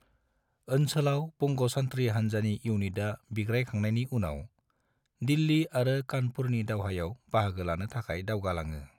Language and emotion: Bodo, neutral